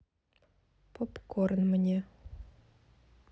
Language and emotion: Russian, neutral